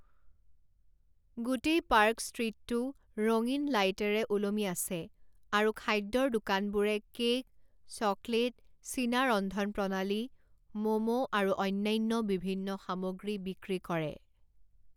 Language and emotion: Assamese, neutral